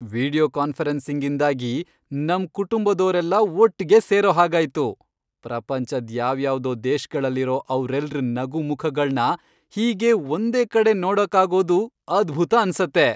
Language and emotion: Kannada, happy